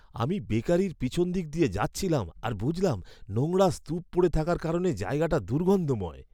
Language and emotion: Bengali, disgusted